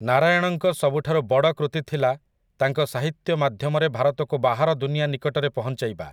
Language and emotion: Odia, neutral